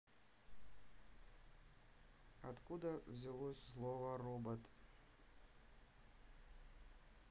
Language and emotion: Russian, neutral